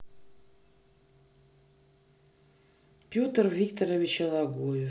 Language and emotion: Russian, neutral